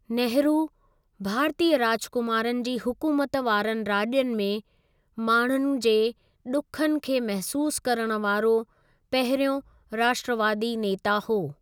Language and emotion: Sindhi, neutral